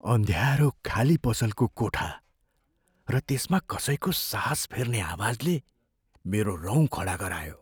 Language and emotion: Nepali, fearful